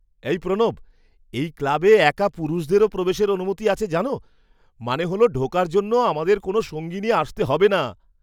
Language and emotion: Bengali, surprised